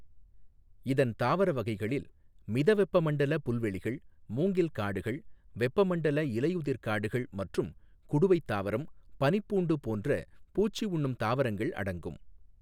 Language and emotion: Tamil, neutral